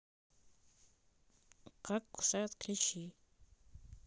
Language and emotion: Russian, neutral